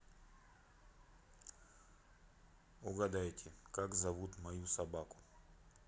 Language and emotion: Russian, neutral